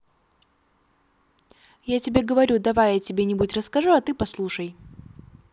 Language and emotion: Russian, positive